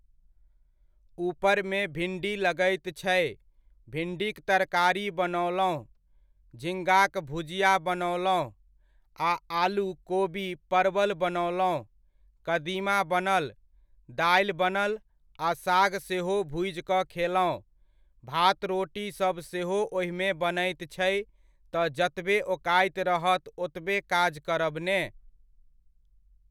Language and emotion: Maithili, neutral